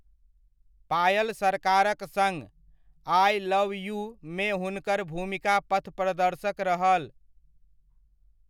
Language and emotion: Maithili, neutral